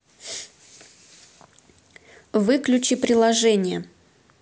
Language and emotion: Russian, neutral